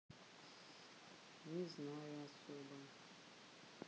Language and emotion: Russian, sad